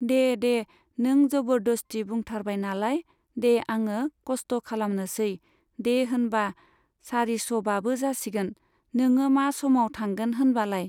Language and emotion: Bodo, neutral